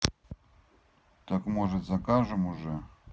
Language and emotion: Russian, neutral